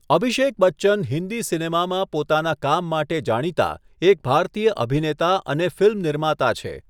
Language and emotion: Gujarati, neutral